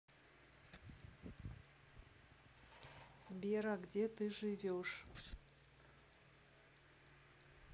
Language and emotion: Russian, neutral